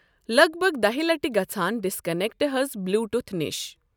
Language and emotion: Kashmiri, neutral